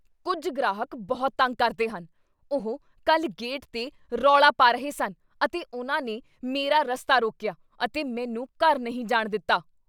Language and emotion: Punjabi, angry